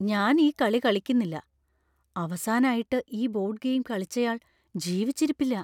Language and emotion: Malayalam, fearful